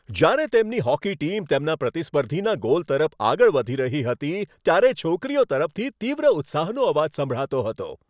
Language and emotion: Gujarati, happy